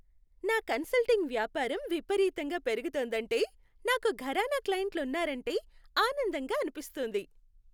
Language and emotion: Telugu, happy